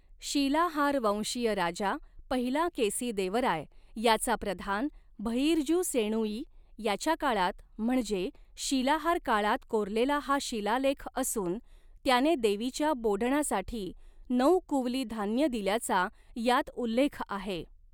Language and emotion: Marathi, neutral